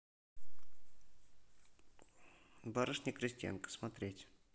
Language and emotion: Russian, neutral